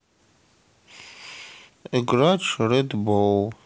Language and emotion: Russian, sad